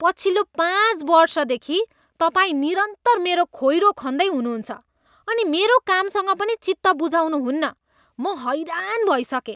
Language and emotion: Nepali, disgusted